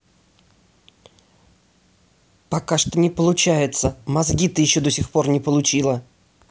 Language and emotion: Russian, angry